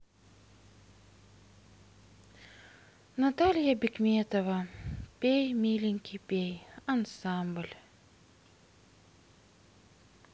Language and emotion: Russian, sad